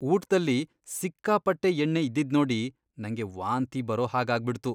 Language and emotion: Kannada, disgusted